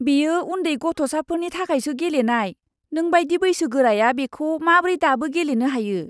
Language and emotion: Bodo, disgusted